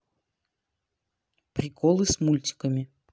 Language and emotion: Russian, neutral